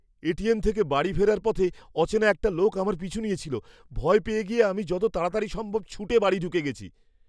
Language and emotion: Bengali, fearful